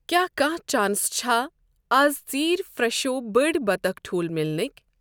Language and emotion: Kashmiri, neutral